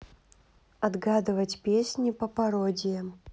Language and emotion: Russian, neutral